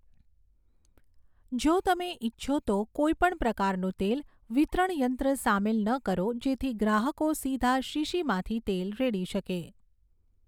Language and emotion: Gujarati, neutral